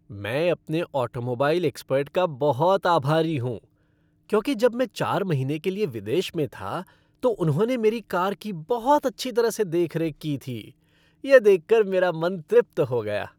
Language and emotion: Hindi, happy